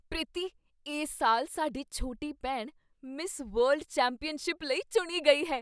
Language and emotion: Punjabi, surprised